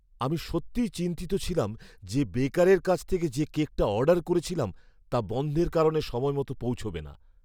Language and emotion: Bengali, fearful